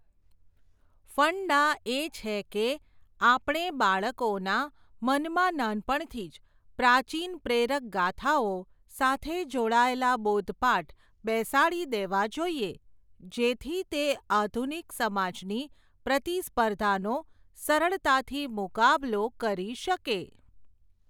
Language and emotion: Gujarati, neutral